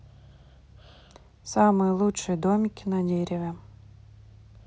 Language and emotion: Russian, neutral